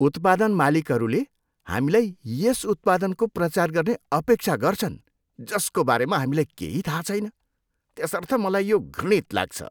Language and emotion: Nepali, disgusted